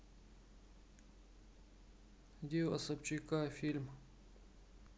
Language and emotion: Russian, sad